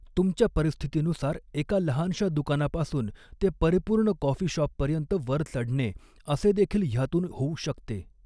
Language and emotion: Marathi, neutral